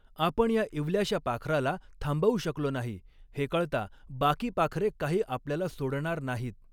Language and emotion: Marathi, neutral